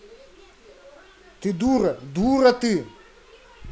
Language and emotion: Russian, angry